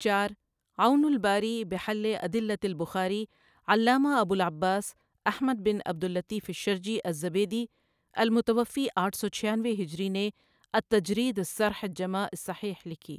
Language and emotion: Urdu, neutral